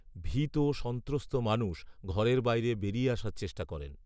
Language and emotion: Bengali, neutral